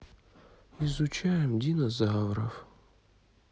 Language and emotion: Russian, sad